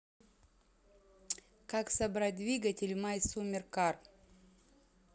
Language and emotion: Russian, neutral